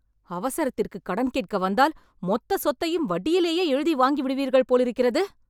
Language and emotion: Tamil, angry